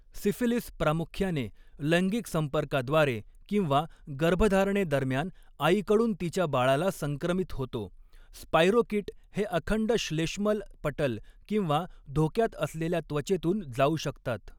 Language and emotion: Marathi, neutral